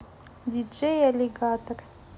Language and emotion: Russian, neutral